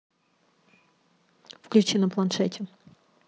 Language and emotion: Russian, neutral